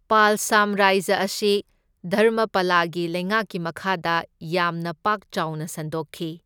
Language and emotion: Manipuri, neutral